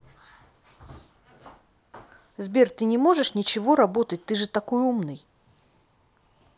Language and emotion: Russian, neutral